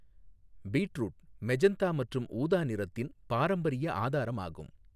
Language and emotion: Tamil, neutral